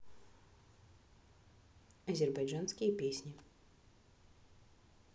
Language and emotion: Russian, neutral